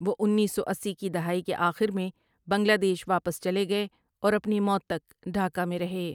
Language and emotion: Urdu, neutral